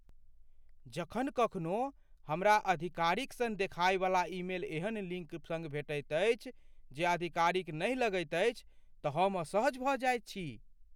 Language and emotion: Maithili, fearful